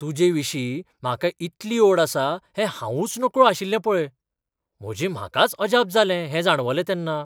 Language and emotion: Goan Konkani, surprised